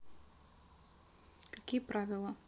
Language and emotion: Russian, neutral